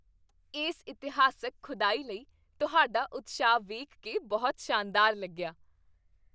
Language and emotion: Punjabi, happy